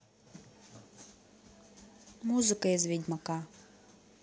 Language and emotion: Russian, neutral